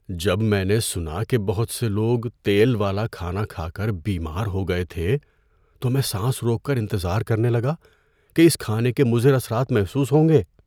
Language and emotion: Urdu, fearful